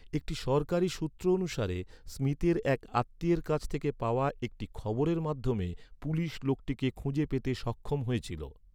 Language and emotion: Bengali, neutral